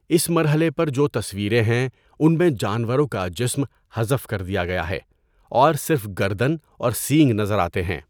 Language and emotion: Urdu, neutral